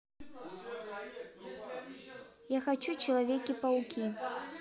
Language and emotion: Russian, neutral